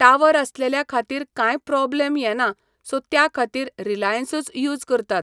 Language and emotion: Goan Konkani, neutral